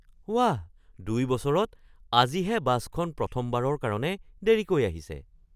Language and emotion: Assamese, surprised